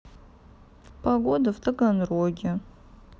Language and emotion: Russian, sad